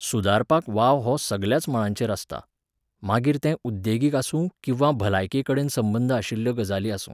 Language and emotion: Goan Konkani, neutral